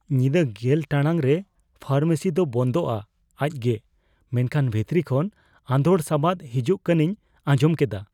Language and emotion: Santali, fearful